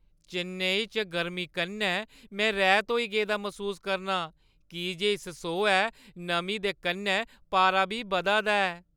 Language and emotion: Dogri, sad